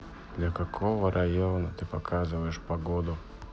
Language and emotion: Russian, sad